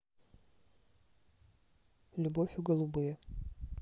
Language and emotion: Russian, neutral